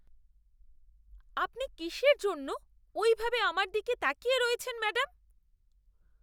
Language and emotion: Bengali, disgusted